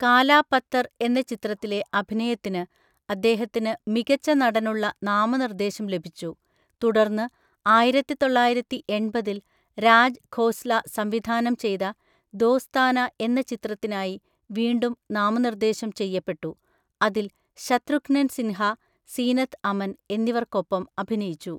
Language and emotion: Malayalam, neutral